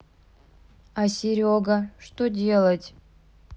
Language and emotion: Russian, neutral